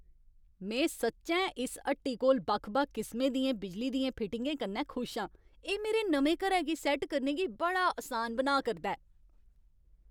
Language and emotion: Dogri, happy